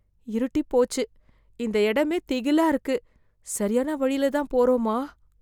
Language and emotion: Tamil, fearful